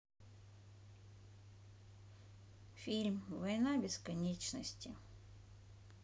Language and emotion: Russian, sad